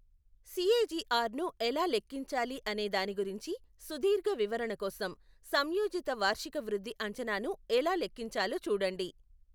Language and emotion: Telugu, neutral